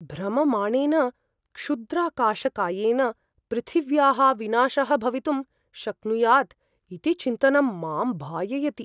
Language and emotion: Sanskrit, fearful